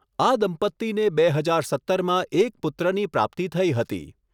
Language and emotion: Gujarati, neutral